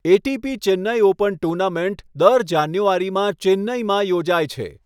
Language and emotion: Gujarati, neutral